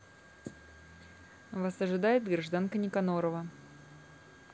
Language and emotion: Russian, neutral